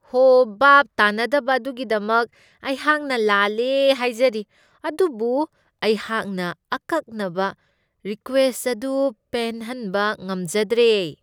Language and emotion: Manipuri, disgusted